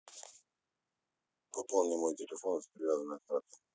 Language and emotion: Russian, neutral